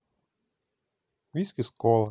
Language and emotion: Russian, neutral